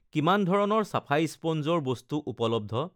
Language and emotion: Assamese, neutral